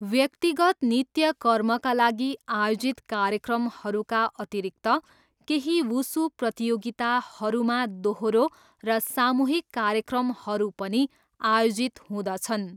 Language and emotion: Nepali, neutral